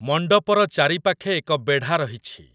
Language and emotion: Odia, neutral